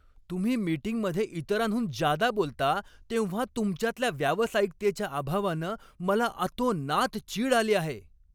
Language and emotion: Marathi, angry